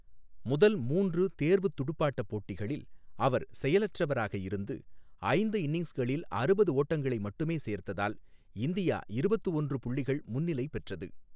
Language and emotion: Tamil, neutral